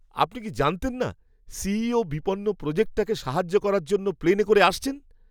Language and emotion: Bengali, surprised